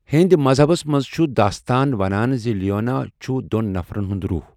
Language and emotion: Kashmiri, neutral